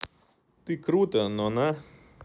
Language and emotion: Russian, neutral